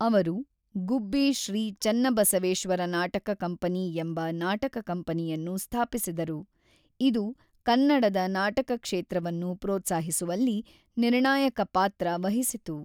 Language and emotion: Kannada, neutral